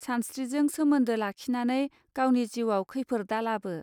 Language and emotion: Bodo, neutral